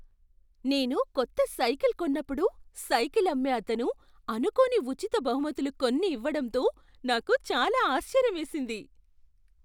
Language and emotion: Telugu, surprised